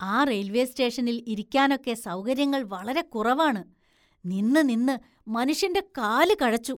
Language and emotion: Malayalam, disgusted